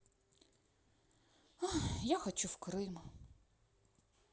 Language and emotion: Russian, sad